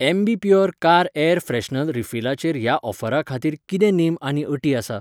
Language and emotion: Goan Konkani, neutral